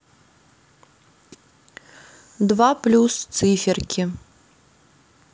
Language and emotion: Russian, neutral